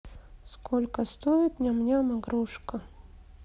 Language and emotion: Russian, sad